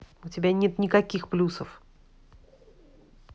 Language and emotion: Russian, angry